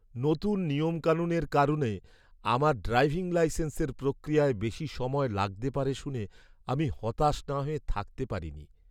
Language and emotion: Bengali, sad